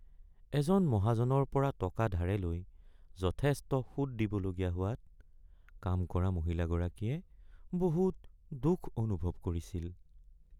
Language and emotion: Assamese, sad